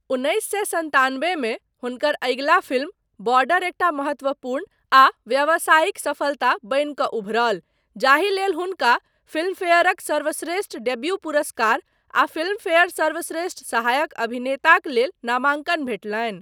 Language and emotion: Maithili, neutral